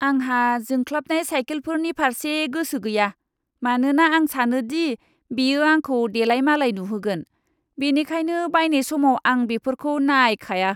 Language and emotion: Bodo, disgusted